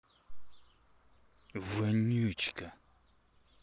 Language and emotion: Russian, angry